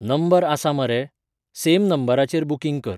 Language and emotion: Goan Konkani, neutral